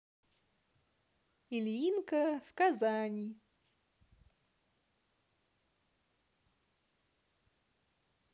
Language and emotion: Russian, positive